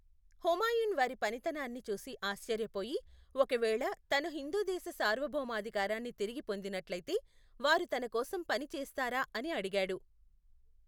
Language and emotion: Telugu, neutral